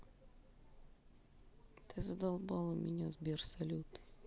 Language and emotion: Russian, angry